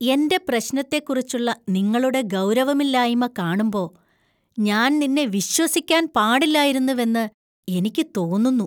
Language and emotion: Malayalam, disgusted